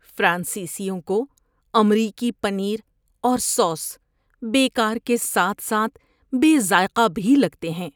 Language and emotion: Urdu, disgusted